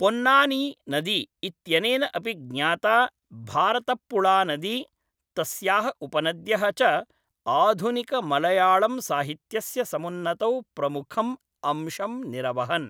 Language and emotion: Sanskrit, neutral